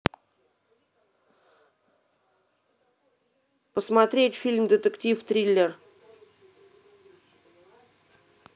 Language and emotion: Russian, neutral